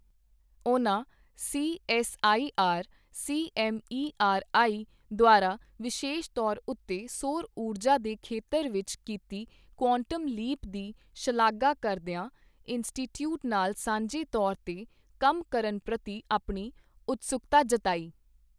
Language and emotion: Punjabi, neutral